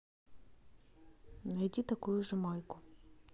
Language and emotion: Russian, neutral